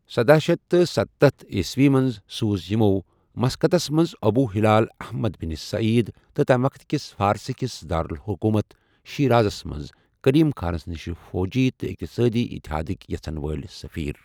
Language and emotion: Kashmiri, neutral